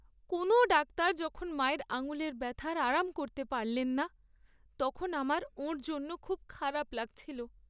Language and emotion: Bengali, sad